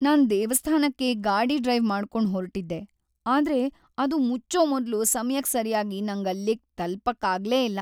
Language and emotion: Kannada, sad